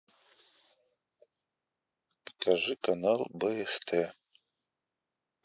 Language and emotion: Russian, neutral